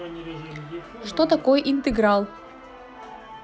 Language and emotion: Russian, positive